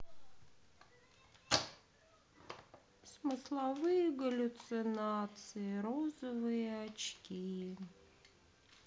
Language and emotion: Russian, sad